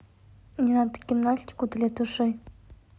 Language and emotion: Russian, neutral